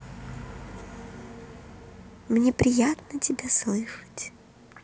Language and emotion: Russian, positive